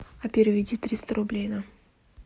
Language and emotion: Russian, neutral